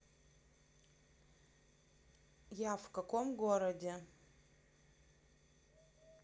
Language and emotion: Russian, neutral